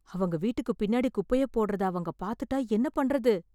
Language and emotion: Tamil, fearful